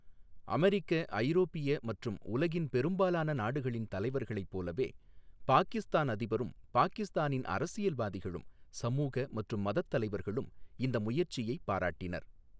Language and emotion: Tamil, neutral